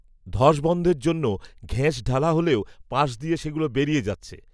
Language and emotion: Bengali, neutral